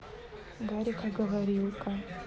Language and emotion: Russian, neutral